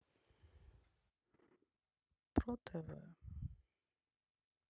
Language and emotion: Russian, sad